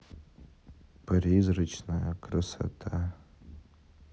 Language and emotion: Russian, sad